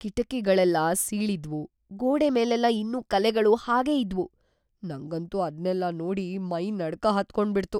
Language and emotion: Kannada, fearful